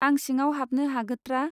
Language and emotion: Bodo, neutral